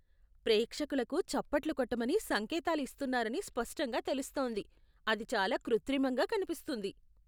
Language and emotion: Telugu, disgusted